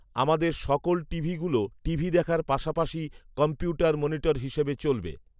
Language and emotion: Bengali, neutral